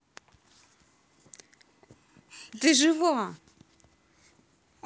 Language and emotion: Russian, positive